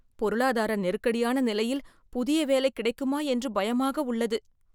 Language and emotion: Tamil, fearful